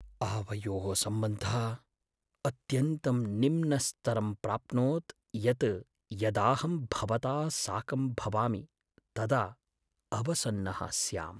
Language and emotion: Sanskrit, sad